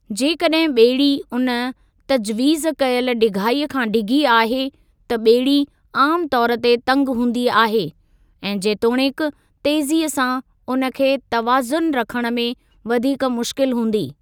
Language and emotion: Sindhi, neutral